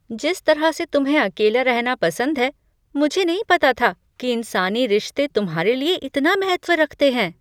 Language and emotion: Hindi, surprised